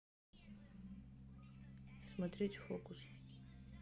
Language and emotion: Russian, neutral